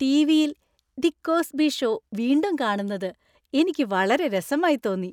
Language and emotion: Malayalam, happy